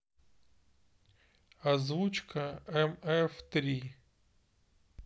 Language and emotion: Russian, neutral